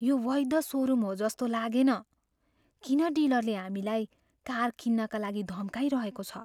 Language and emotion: Nepali, fearful